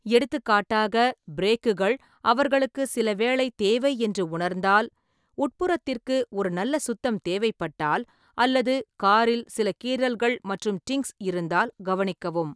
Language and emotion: Tamil, neutral